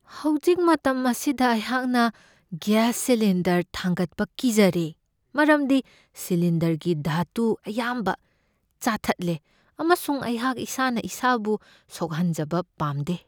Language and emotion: Manipuri, fearful